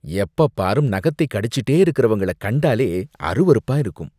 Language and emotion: Tamil, disgusted